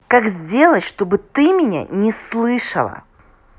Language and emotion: Russian, angry